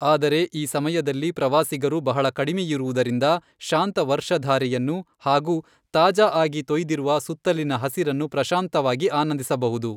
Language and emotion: Kannada, neutral